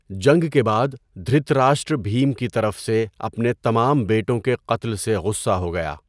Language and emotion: Urdu, neutral